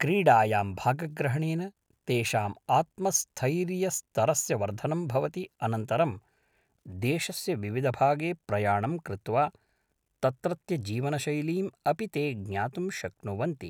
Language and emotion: Sanskrit, neutral